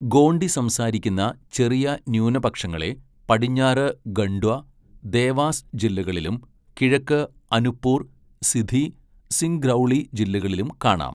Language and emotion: Malayalam, neutral